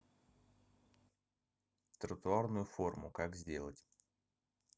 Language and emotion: Russian, neutral